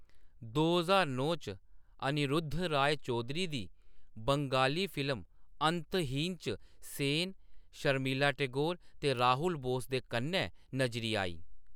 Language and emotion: Dogri, neutral